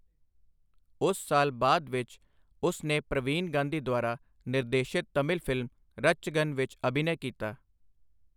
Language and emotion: Punjabi, neutral